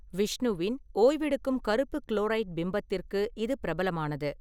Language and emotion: Tamil, neutral